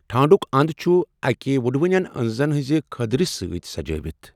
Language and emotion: Kashmiri, neutral